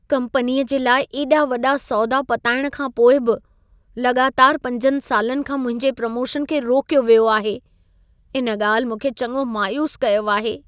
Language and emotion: Sindhi, sad